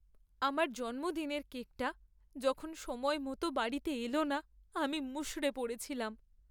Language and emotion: Bengali, sad